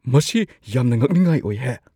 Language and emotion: Manipuri, surprised